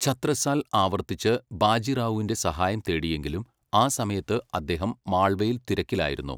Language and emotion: Malayalam, neutral